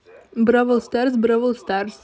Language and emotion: Russian, neutral